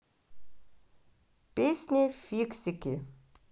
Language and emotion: Russian, positive